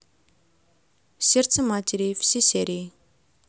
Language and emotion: Russian, neutral